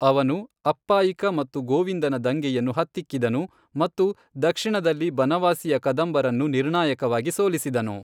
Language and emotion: Kannada, neutral